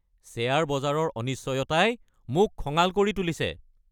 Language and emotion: Assamese, angry